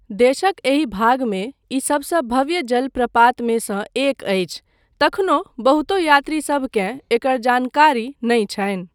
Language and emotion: Maithili, neutral